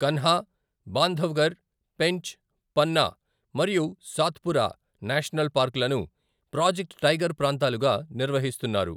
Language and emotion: Telugu, neutral